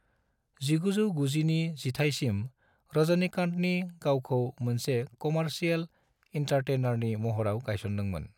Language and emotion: Bodo, neutral